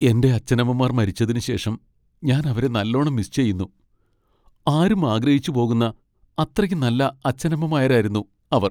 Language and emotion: Malayalam, sad